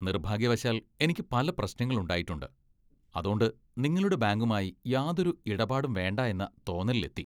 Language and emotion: Malayalam, disgusted